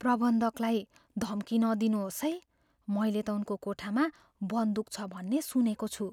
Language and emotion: Nepali, fearful